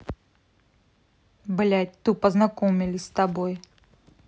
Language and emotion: Russian, angry